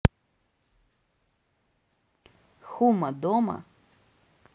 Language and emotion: Russian, neutral